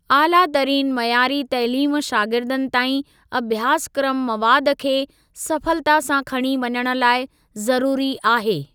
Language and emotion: Sindhi, neutral